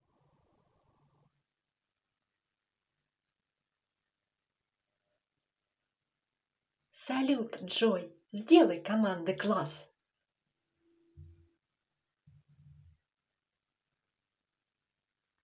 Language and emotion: Russian, positive